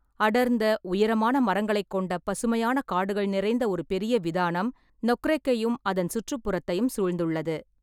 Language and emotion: Tamil, neutral